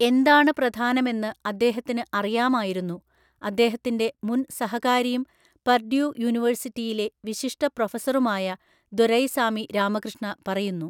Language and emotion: Malayalam, neutral